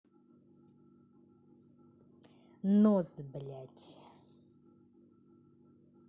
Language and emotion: Russian, angry